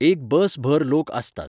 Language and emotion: Goan Konkani, neutral